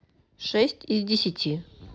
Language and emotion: Russian, neutral